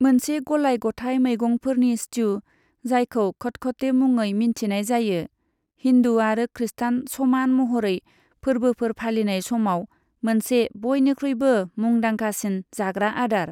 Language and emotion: Bodo, neutral